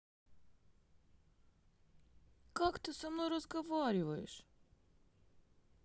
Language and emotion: Russian, sad